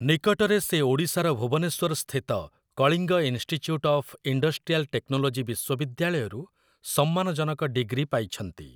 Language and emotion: Odia, neutral